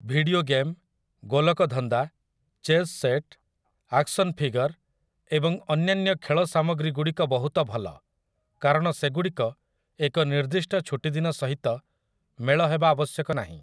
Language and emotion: Odia, neutral